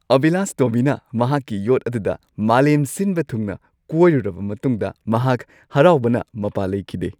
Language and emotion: Manipuri, happy